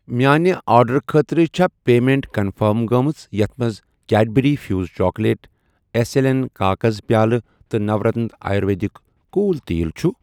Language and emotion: Kashmiri, neutral